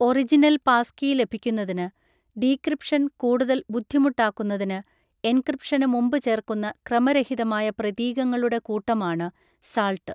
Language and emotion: Malayalam, neutral